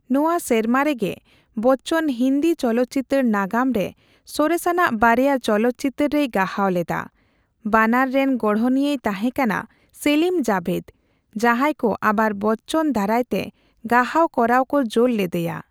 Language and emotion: Santali, neutral